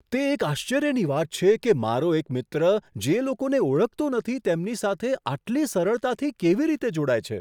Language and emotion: Gujarati, surprised